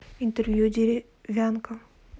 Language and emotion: Russian, neutral